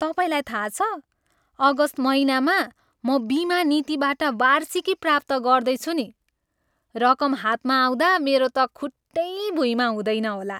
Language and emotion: Nepali, happy